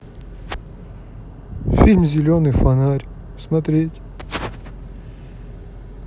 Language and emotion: Russian, sad